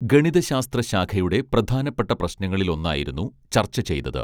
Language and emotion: Malayalam, neutral